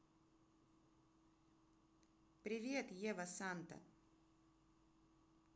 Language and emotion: Russian, neutral